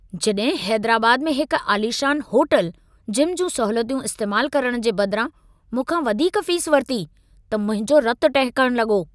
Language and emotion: Sindhi, angry